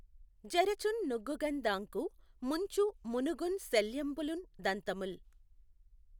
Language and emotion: Telugu, neutral